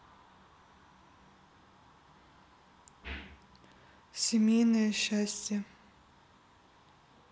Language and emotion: Russian, neutral